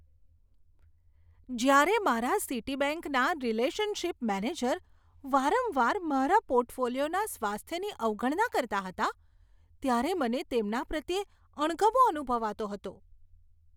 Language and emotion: Gujarati, disgusted